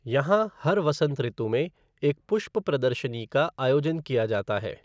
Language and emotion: Hindi, neutral